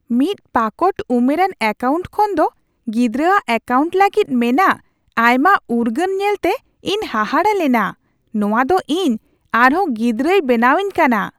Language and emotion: Santali, surprised